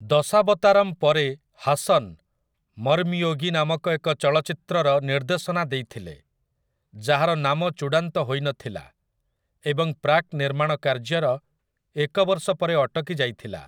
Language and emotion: Odia, neutral